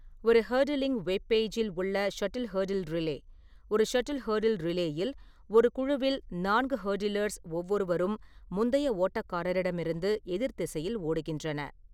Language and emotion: Tamil, neutral